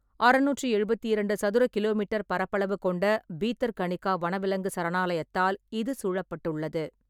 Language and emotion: Tamil, neutral